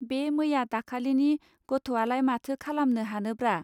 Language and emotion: Bodo, neutral